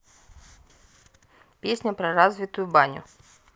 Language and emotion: Russian, neutral